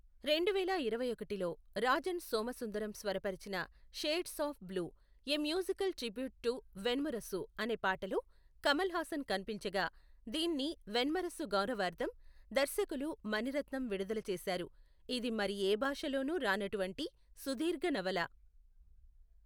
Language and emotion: Telugu, neutral